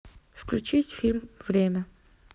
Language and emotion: Russian, neutral